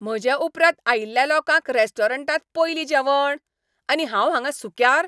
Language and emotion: Goan Konkani, angry